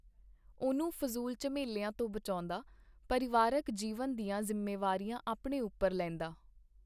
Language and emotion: Punjabi, neutral